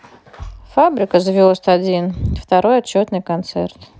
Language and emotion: Russian, neutral